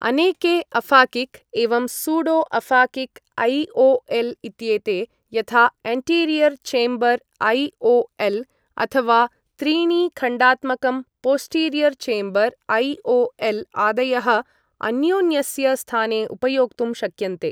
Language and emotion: Sanskrit, neutral